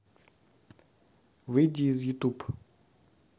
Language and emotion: Russian, neutral